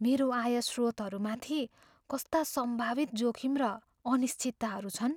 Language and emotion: Nepali, fearful